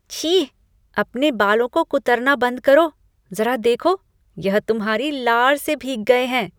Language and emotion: Hindi, disgusted